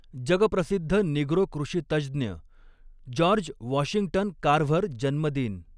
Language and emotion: Marathi, neutral